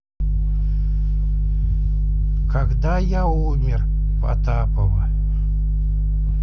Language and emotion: Russian, neutral